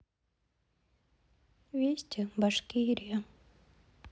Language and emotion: Russian, sad